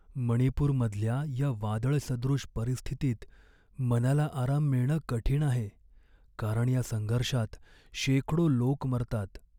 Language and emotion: Marathi, sad